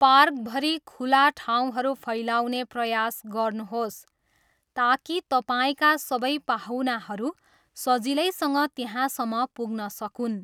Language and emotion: Nepali, neutral